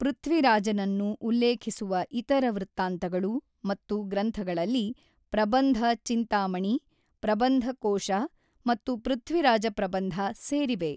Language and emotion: Kannada, neutral